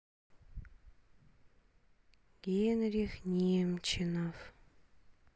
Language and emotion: Russian, sad